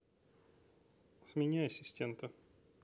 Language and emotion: Russian, neutral